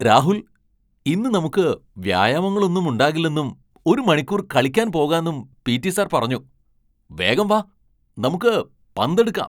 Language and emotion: Malayalam, surprised